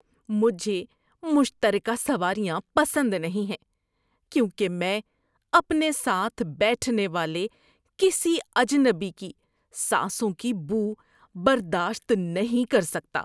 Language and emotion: Urdu, disgusted